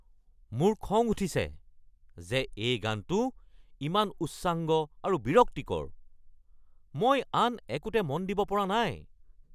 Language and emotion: Assamese, angry